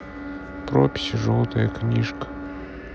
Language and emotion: Russian, sad